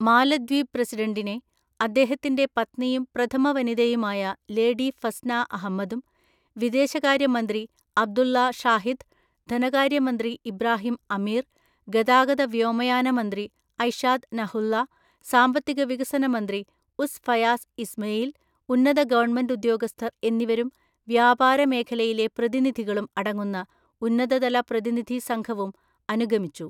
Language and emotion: Malayalam, neutral